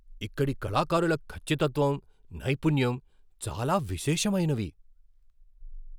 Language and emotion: Telugu, surprised